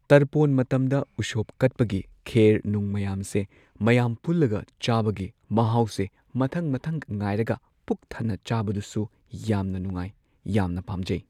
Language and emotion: Manipuri, neutral